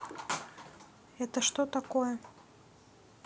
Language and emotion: Russian, neutral